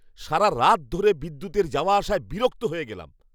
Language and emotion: Bengali, angry